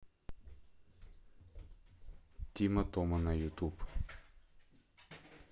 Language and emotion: Russian, neutral